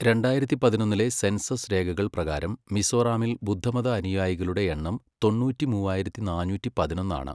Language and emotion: Malayalam, neutral